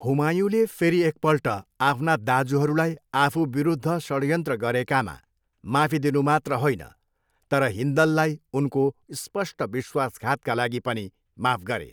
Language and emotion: Nepali, neutral